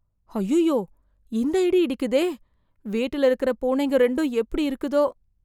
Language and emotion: Tamil, fearful